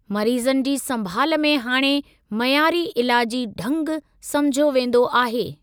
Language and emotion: Sindhi, neutral